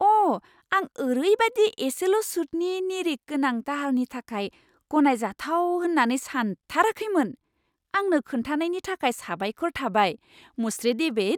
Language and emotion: Bodo, surprised